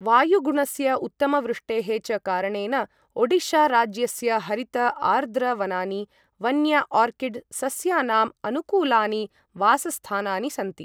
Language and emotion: Sanskrit, neutral